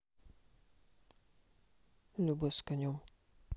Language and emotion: Russian, neutral